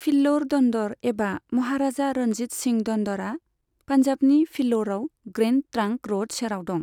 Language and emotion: Bodo, neutral